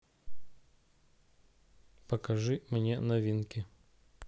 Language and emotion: Russian, neutral